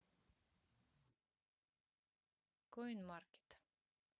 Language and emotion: Russian, neutral